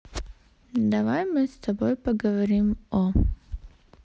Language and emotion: Russian, neutral